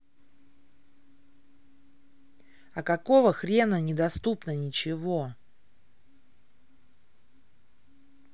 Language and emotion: Russian, angry